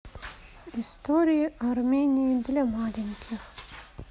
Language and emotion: Russian, neutral